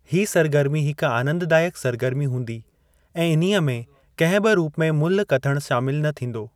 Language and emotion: Sindhi, neutral